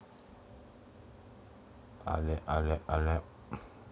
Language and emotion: Russian, neutral